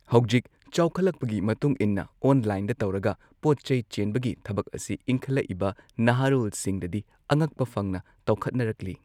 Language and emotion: Manipuri, neutral